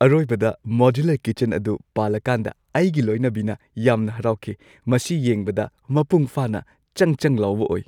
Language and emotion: Manipuri, happy